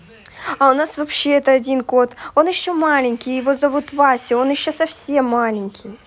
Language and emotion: Russian, positive